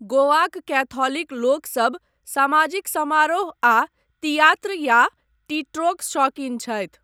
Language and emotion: Maithili, neutral